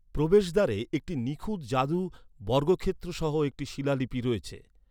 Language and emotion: Bengali, neutral